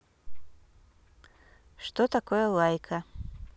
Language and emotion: Russian, neutral